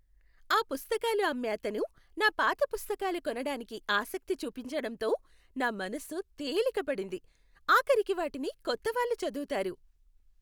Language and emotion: Telugu, happy